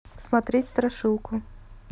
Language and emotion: Russian, neutral